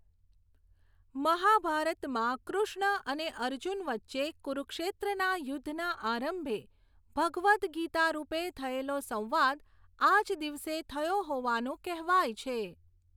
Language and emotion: Gujarati, neutral